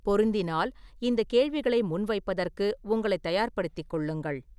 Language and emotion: Tamil, neutral